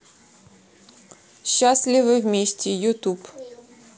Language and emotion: Russian, neutral